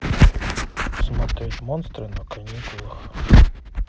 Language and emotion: Russian, neutral